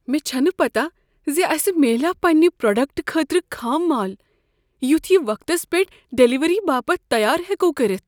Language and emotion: Kashmiri, fearful